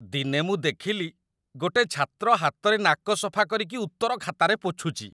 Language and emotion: Odia, disgusted